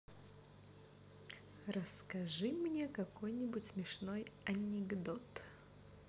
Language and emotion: Russian, positive